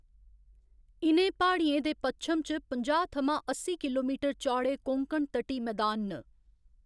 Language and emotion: Dogri, neutral